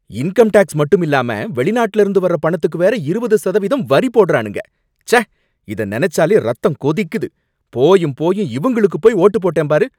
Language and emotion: Tamil, angry